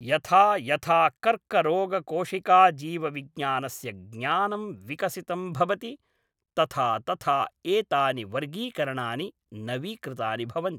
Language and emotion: Sanskrit, neutral